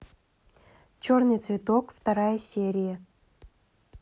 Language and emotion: Russian, neutral